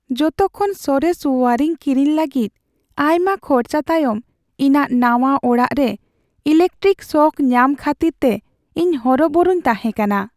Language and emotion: Santali, sad